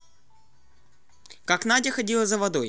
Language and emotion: Russian, neutral